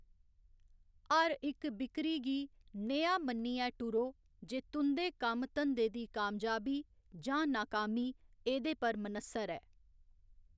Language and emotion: Dogri, neutral